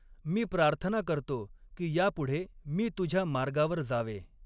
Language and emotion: Marathi, neutral